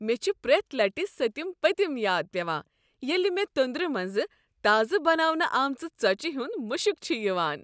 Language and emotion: Kashmiri, happy